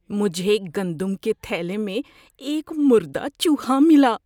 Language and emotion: Urdu, disgusted